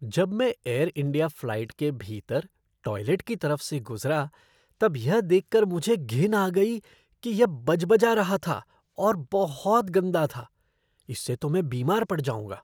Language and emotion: Hindi, disgusted